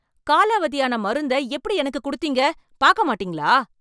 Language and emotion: Tamil, angry